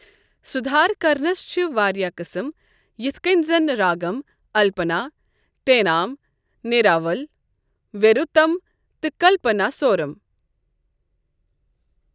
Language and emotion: Kashmiri, neutral